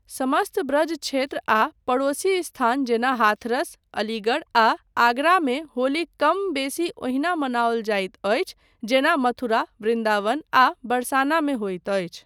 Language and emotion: Maithili, neutral